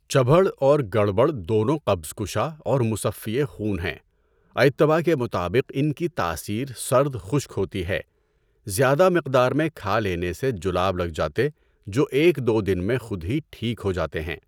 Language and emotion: Urdu, neutral